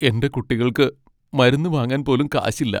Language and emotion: Malayalam, sad